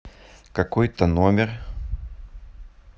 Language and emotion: Russian, neutral